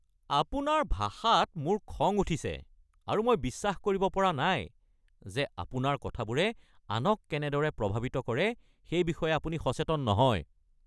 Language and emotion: Assamese, angry